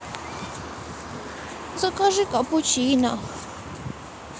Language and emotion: Russian, sad